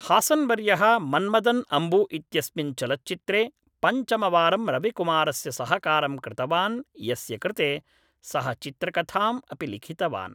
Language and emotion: Sanskrit, neutral